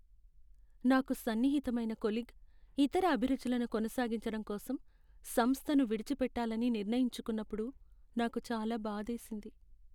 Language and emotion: Telugu, sad